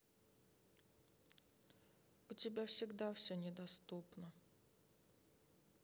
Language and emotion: Russian, sad